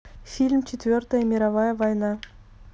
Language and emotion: Russian, neutral